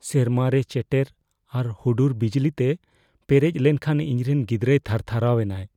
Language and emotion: Santali, fearful